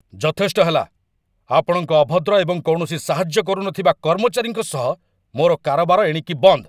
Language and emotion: Odia, angry